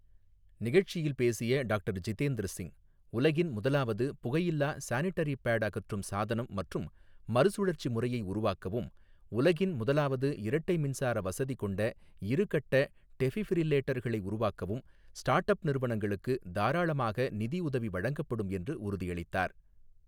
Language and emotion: Tamil, neutral